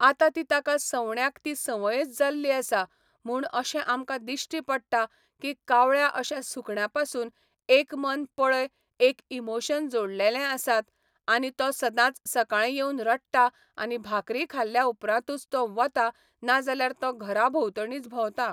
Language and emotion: Goan Konkani, neutral